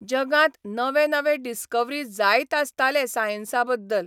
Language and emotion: Goan Konkani, neutral